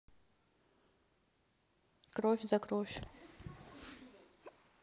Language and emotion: Russian, neutral